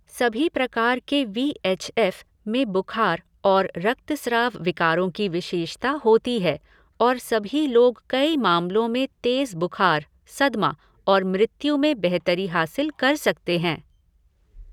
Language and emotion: Hindi, neutral